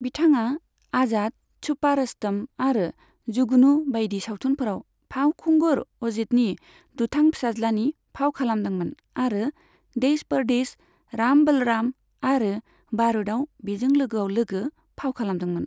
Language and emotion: Bodo, neutral